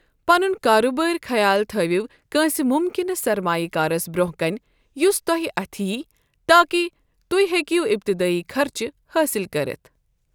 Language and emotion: Kashmiri, neutral